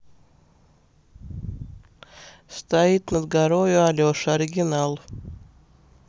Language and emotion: Russian, neutral